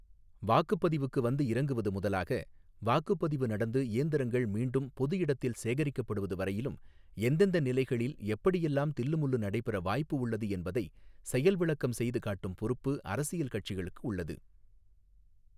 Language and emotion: Tamil, neutral